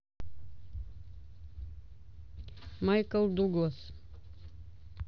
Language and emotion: Russian, neutral